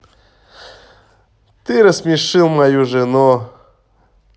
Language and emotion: Russian, positive